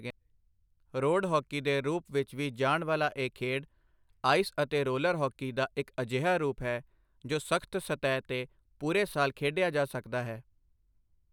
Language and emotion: Punjabi, neutral